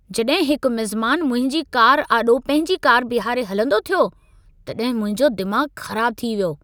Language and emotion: Sindhi, angry